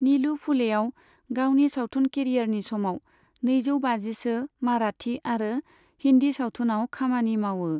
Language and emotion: Bodo, neutral